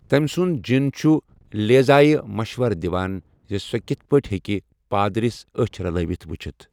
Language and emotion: Kashmiri, neutral